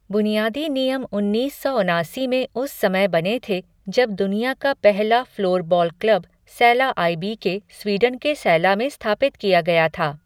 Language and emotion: Hindi, neutral